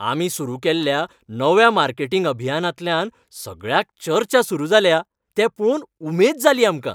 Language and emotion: Goan Konkani, happy